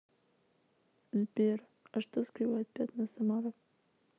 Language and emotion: Russian, sad